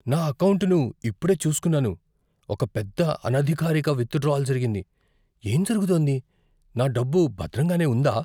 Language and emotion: Telugu, fearful